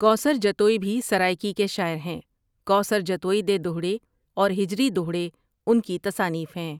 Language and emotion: Urdu, neutral